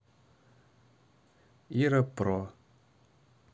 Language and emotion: Russian, neutral